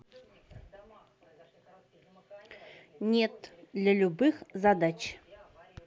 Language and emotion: Russian, neutral